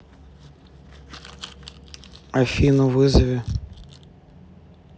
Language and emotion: Russian, neutral